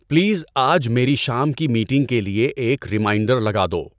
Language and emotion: Urdu, neutral